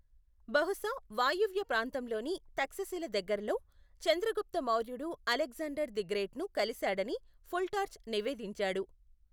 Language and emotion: Telugu, neutral